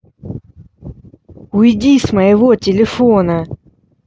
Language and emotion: Russian, angry